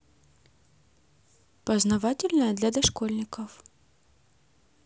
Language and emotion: Russian, positive